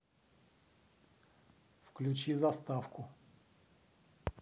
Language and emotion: Russian, neutral